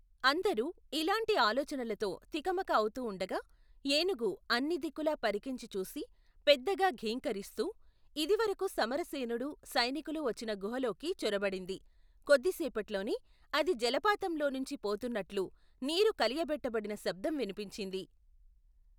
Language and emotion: Telugu, neutral